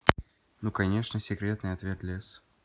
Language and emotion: Russian, neutral